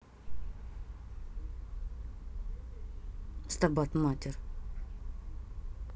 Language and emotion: Russian, angry